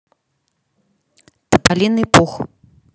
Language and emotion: Russian, neutral